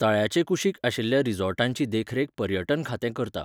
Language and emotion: Goan Konkani, neutral